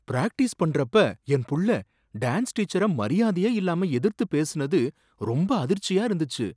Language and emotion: Tamil, surprised